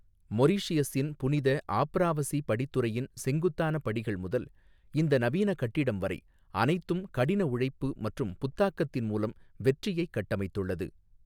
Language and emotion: Tamil, neutral